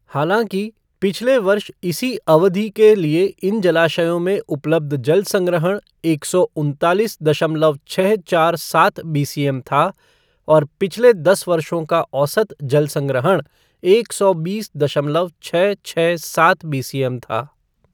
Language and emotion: Hindi, neutral